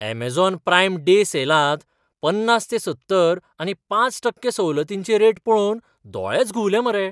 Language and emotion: Goan Konkani, surprised